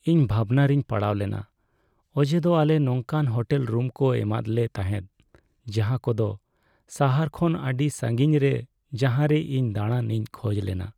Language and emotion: Santali, sad